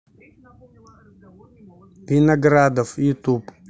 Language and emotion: Russian, neutral